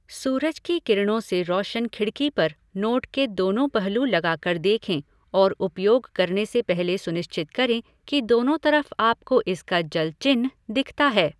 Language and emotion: Hindi, neutral